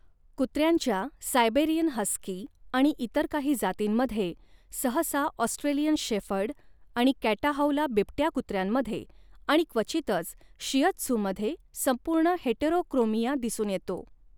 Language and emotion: Marathi, neutral